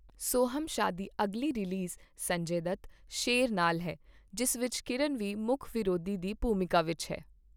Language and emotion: Punjabi, neutral